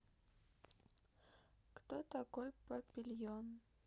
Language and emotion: Russian, sad